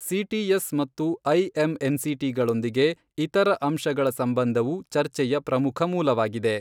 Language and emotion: Kannada, neutral